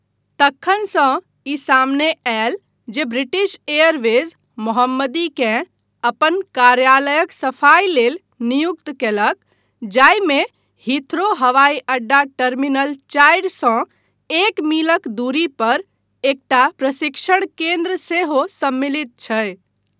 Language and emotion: Maithili, neutral